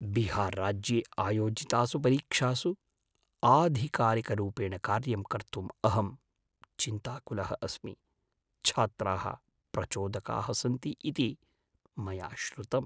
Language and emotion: Sanskrit, fearful